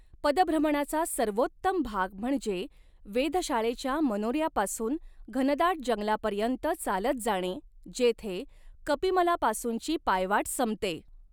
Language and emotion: Marathi, neutral